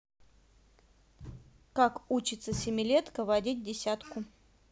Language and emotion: Russian, neutral